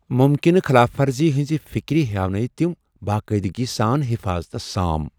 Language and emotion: Kashmiri, fearful